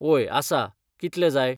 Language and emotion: Goan Konkani, neutral